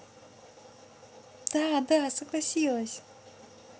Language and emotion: Russian, positive